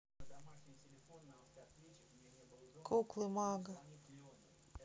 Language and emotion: Russian, neutral